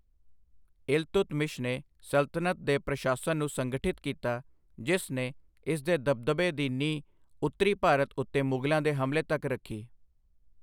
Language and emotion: Punjabi, neutral